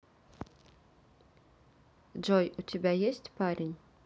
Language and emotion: Russian, neutral